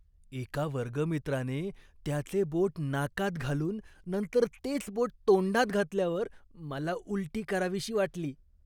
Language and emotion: Marathi, disgusted